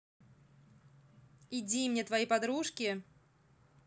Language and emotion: Russian, angry